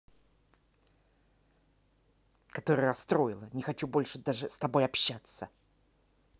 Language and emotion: Russian, angry